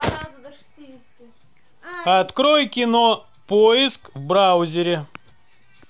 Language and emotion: Russian, neutral